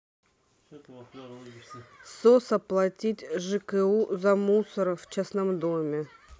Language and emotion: Russian, neutral